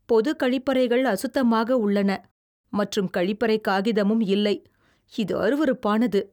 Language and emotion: Tamil, disgusted